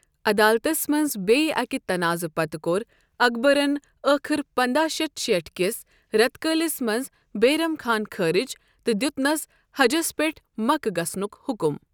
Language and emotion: Kashmiri, neutral